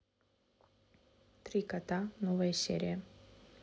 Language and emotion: Russian, neutral